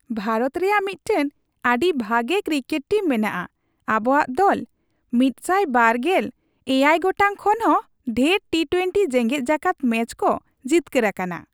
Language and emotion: Santali, happy